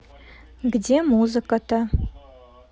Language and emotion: Russian, neutral